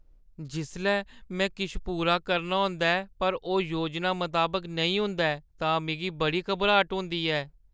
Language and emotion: Dogri, fearful